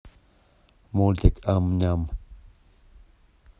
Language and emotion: Russian, neutral